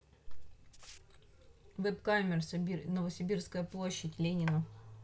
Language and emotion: Russian, neutral